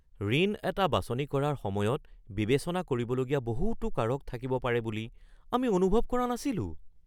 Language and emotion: Assamese, surprised